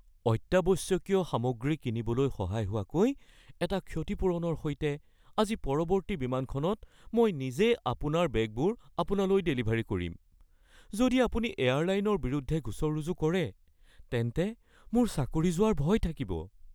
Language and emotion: Assamese, fearful